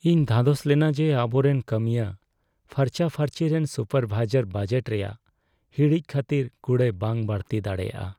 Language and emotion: Santali, sad